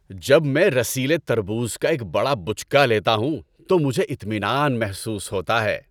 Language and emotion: Urdu, happy